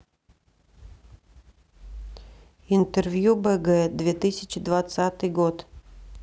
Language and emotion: Russian, neutral